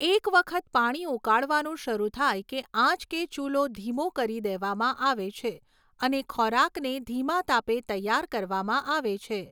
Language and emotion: Gujarati, neutral